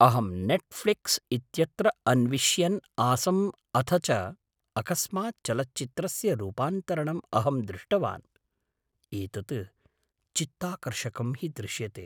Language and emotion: Sanskrit, surprised